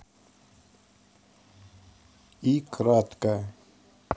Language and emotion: Russian, neutral